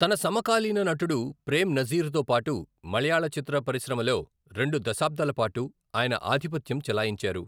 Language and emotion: Telugu, neutral